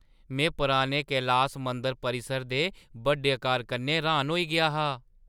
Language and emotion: Dogri, surprised